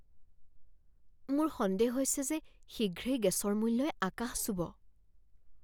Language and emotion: Assamese, fearful